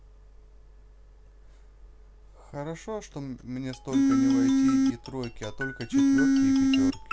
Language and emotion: Russian, neutral